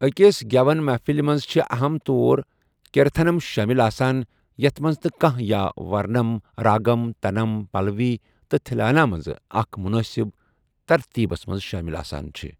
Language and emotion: Kashmiri, neutral